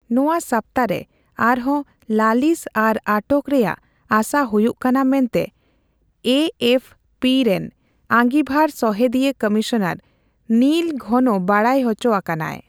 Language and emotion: Santali, neutral